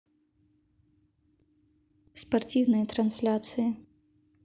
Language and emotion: Russian, neutral